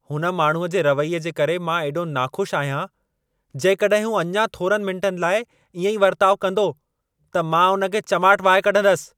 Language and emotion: Sindhi, angry